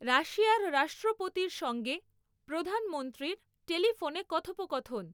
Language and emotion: Bengali, neutral